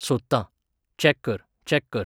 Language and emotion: Goan Konkani, neutral